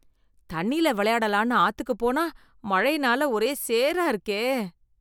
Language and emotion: Tamil, disgusted